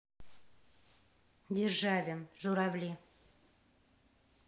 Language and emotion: Russian, neutral